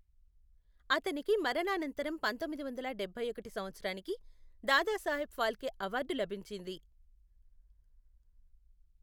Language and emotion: Telugu, neutral